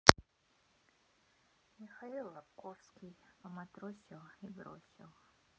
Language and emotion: Russian, sad